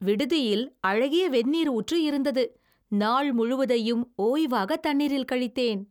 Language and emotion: Tamil, happy